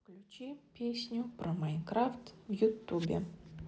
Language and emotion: Russian, neutral